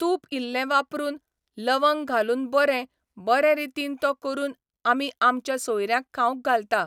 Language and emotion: Goan Konkani, neutral